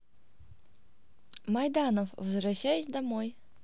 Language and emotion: Russian, positive